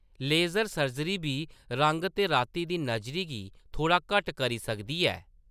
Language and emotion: Dogri, neutral